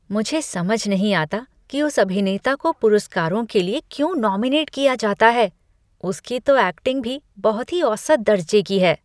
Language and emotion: Hindi, disgusted